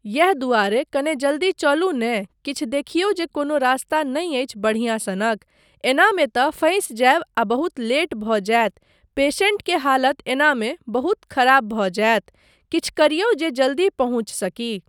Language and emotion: Maithili, neutral